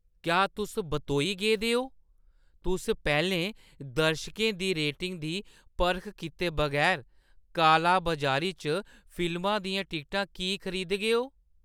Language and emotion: Dogri, surprised